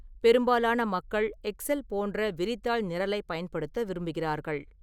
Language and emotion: Tamil, neutral